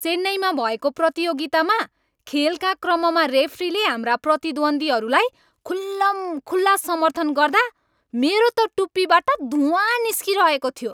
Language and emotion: Nepali, angry